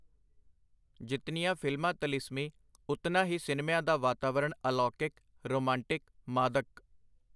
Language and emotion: Punjabi, neutral